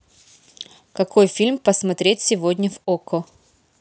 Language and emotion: Russian, neutral